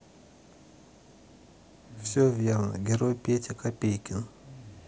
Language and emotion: Russian, sad